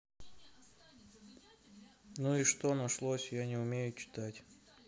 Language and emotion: Russian, sad